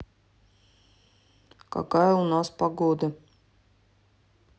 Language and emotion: Russian, neutral